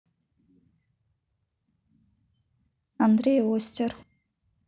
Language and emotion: Russian, neutral